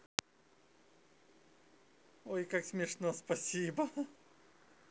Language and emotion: Russian, positive